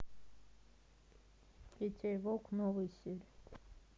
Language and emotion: Russian, neutral